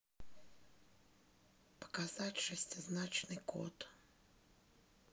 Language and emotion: Russian, neutral